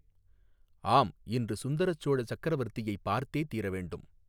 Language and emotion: Tamil, neutral